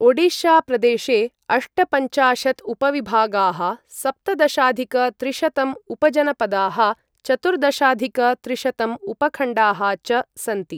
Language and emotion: Sanskrit, neutral